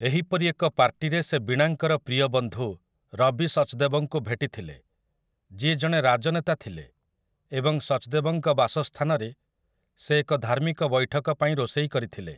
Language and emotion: Odia, neutral